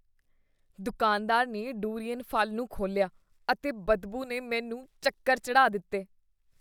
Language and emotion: Punjabi, disgusted